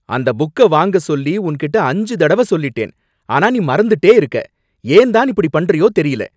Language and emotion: Tamil, angry